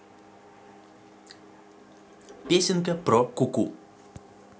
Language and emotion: Russian, neutral